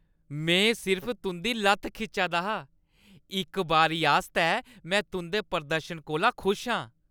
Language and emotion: Dogri, happy